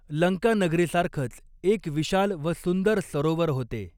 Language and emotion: Marathi, neutral